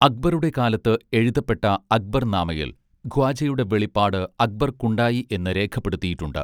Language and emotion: Malayalam, neutral